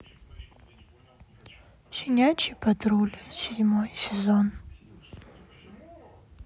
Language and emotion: Russian, sad